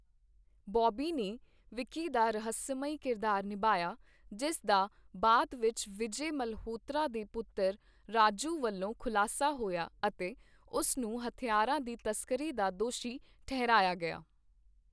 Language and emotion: Punjabi, neutral